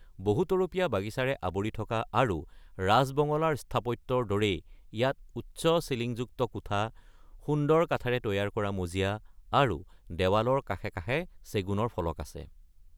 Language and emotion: Assamese, neutral